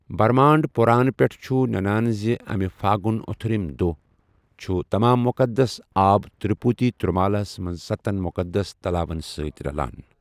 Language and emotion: Kashmiri, neutral